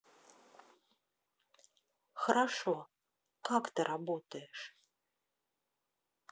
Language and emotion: Russian, neutral